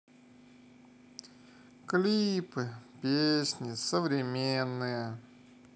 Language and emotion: Russian, sad